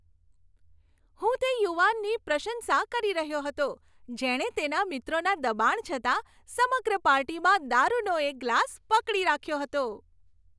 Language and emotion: Gujarati, happy